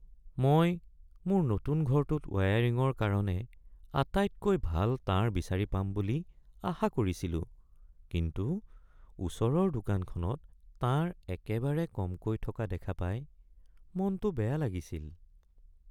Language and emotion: Assamese, sad